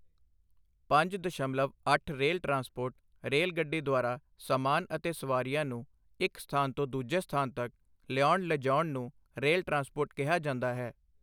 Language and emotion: Punjabi, neutral